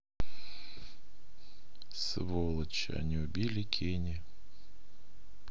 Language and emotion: Russian, sad